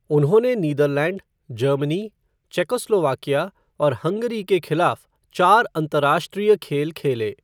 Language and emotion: Hindi, neutral